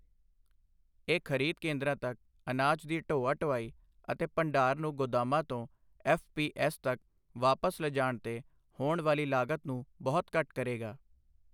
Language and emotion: Punjabi, neutral